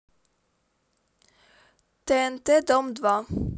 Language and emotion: Russian, neutral